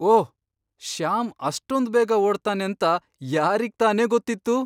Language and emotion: Kannada, surprised